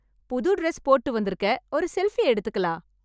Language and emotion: Tamil, happy